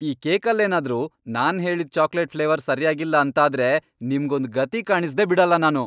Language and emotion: Kannada, angry